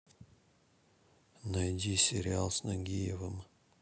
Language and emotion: Russian, neutral